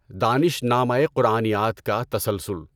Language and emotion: Urdu, neutral